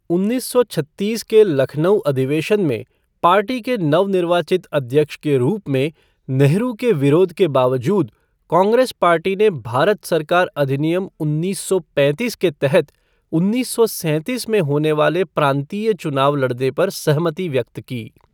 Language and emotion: Hindi, neutral